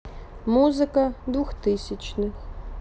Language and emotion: Russian, neutral